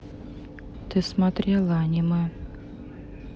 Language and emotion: Russian, sad